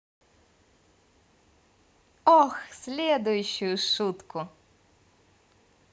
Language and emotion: Russian, positive